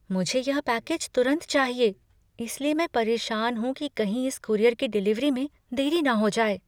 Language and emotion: Hindi, fearful